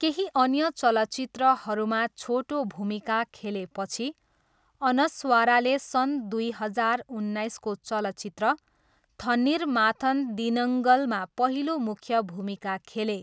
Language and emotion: Nepali, neutral